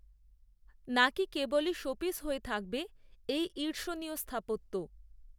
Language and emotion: Bengali, neutral